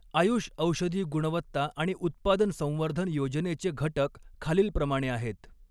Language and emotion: Marathi, neutral